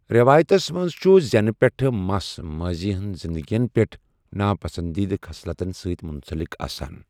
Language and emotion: Kashmiri, neutral